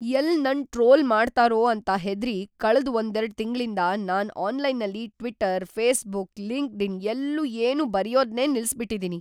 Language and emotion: Kannada, fearful